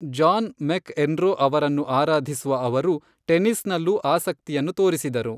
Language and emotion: Kannada, neutral